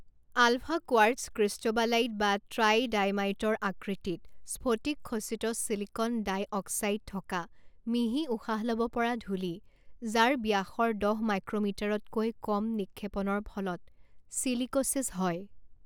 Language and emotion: Assamese, neutral